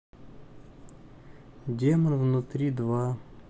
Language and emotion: Russian, sad